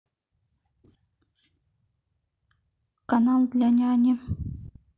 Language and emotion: Russian, neutral